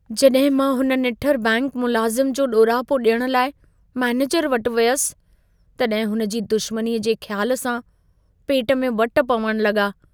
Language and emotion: Sindhi, fearful